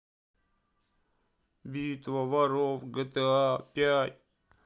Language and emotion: Russian, sad